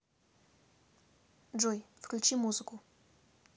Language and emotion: Russian, neutral